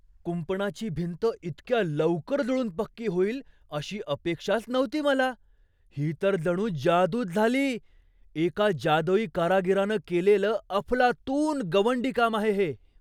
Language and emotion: Marathi, surprised